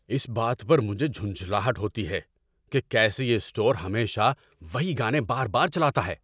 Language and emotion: Urdu, angry